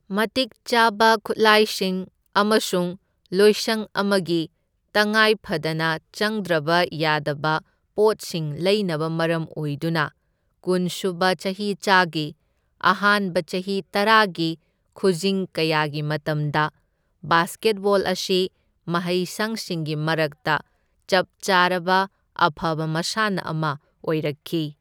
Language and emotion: Manipuri, neutral